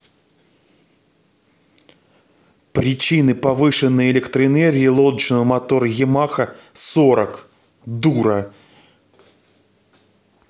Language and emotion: Russian, angry